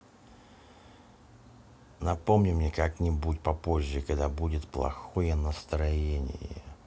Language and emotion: Russian, neutral